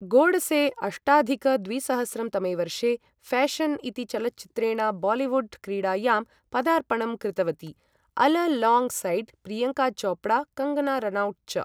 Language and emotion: Sanskrit, neutral